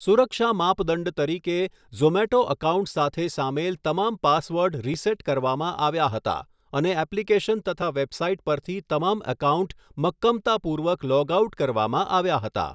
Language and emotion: Gujarati, neutral